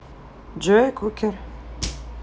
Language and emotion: Russian, neutral